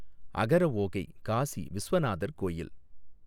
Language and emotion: Tamil, neutral